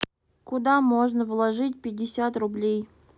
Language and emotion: Russian, sad